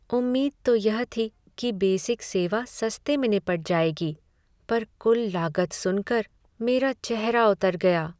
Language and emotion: Hindi, sad